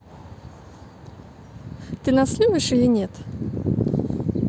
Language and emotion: Russian, positive